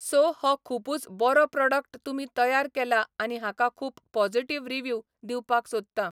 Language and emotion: Goan Konkani, neutral